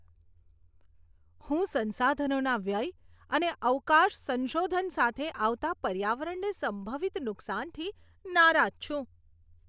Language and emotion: Gujarati, disgusted